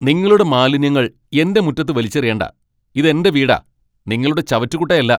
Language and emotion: Malayalam, angry